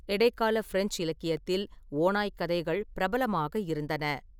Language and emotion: Tamil, neutral